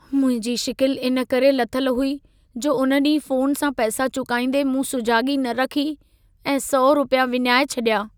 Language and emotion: Sindhi, sad